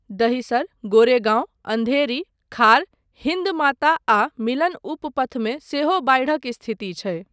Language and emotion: Maithili, neutral